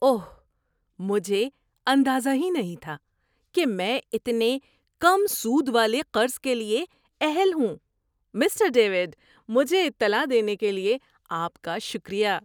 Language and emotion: Urdu, surprised